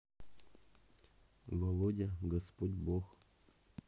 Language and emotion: Russian, neutral